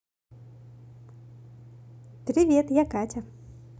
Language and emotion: Russian, positive